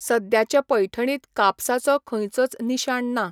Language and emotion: Goan Konkani, neutral